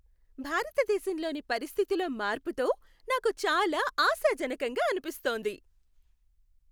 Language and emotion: Telugu, happy